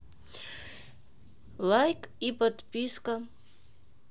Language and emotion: Russian, neutral